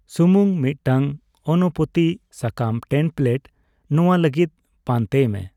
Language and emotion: Santali, neutral